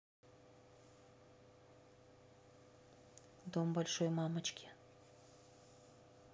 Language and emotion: Russian, neutral